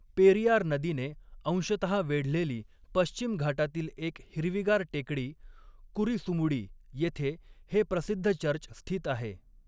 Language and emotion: Marathi, neutral